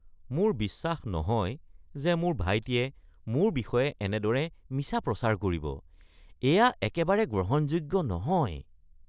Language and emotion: Assamese, disgusted